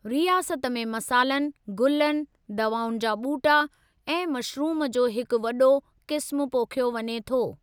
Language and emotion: Sindhi, neutral